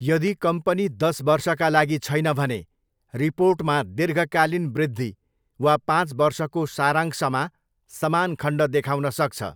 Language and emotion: Nepali, neutral